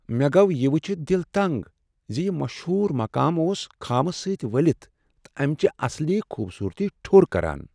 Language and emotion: Kashmiri, sad